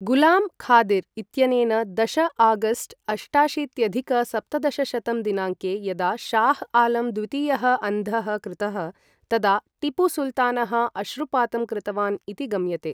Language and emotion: Sanskrit, neutral